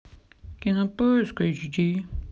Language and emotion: Russian, sad